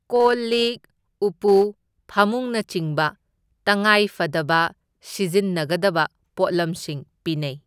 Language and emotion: Manipuri, neutral